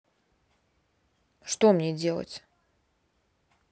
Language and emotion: Russian, neutral